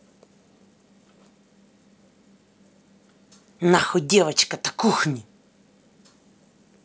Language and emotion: Russian, angry